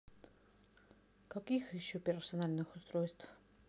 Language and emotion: Russian, neutral